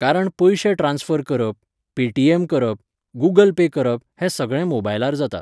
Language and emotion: Goan Konkani, neutral